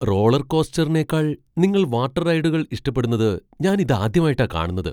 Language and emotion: Malayalam, surprised